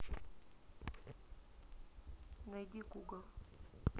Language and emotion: Russian, neutral